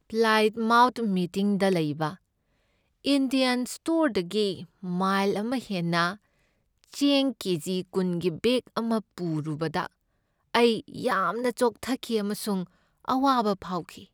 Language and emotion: Manipuri, sad